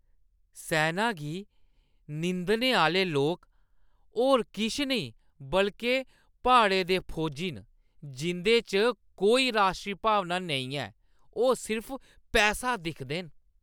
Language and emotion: Dogri, disgusted